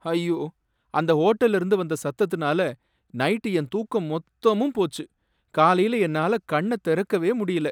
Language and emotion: Tamil, sad